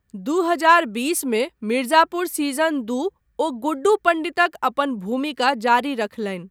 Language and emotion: Maithili, neutral